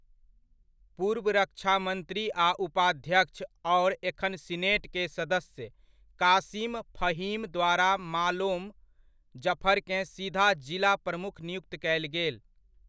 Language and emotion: Maithili, neutral